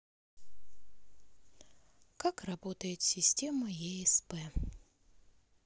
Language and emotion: Russian, sad